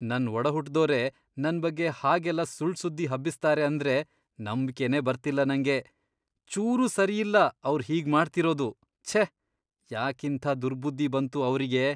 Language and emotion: Kannada, disgusted